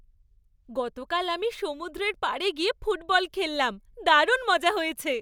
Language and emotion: Bengali, happy